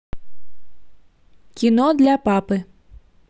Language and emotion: Russian, neutral